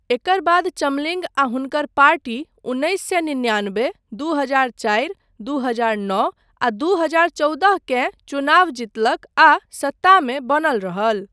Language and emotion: Maithili, neutral